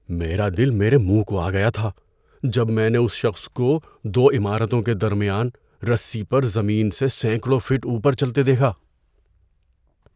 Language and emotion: Urdu, fearful